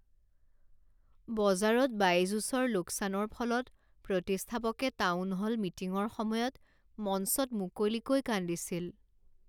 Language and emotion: Assamese, sad